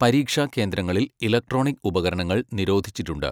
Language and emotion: Malayalam, neutral